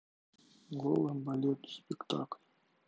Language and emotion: Russian, sad